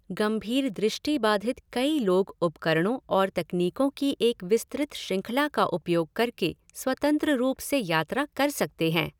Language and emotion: Hindi, neutral